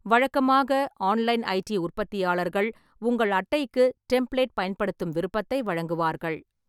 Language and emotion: Tamil, neutral